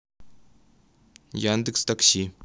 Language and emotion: Russian, neutral